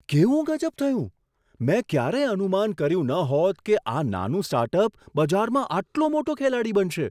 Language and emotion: Gujarati, surprised